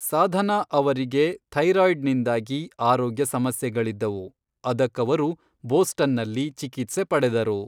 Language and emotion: Kannada, neutral